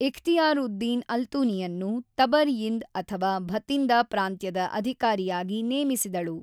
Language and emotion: Kannada, neutral